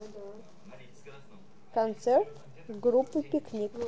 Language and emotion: Russian, neutral